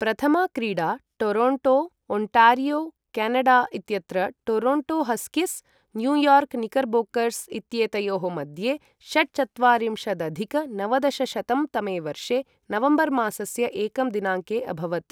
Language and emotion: Sanskrit, neutral